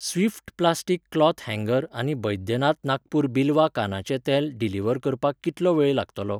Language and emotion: Goan Konkani, neutral